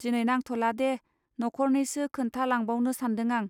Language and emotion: Bodo, neutral